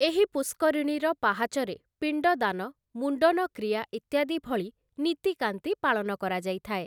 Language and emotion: Odia, neutral